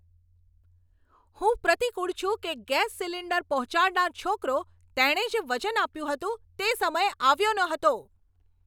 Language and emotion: Gujarati, angry